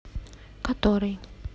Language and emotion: Russian, neutral